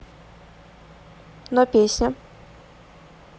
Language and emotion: Russian, neutral